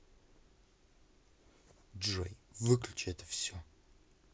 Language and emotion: Russian, angry